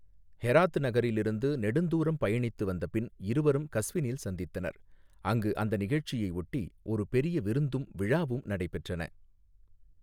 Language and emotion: Tamil, neutral